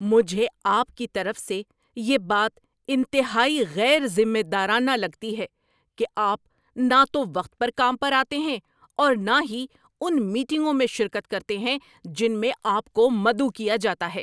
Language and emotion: Urdu, angry